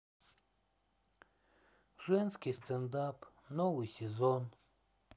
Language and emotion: Russian, sad